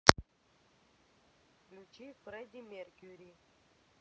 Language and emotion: Russian, neutral